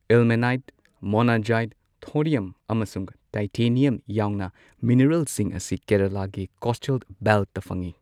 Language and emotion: Manipuri, neutral